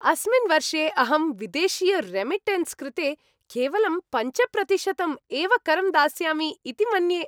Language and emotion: Sanskrit, happy